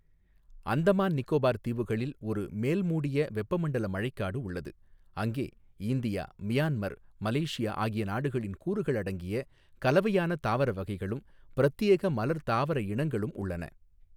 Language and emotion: Tamil, neutral